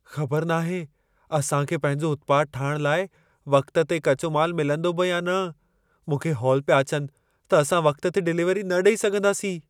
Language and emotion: Sindhi, fearful